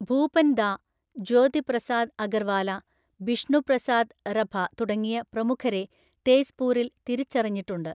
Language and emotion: Malayalam, neutral